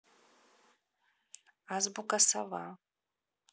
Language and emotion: Russian, neutral